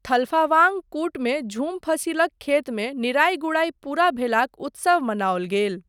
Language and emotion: Maithili, neutral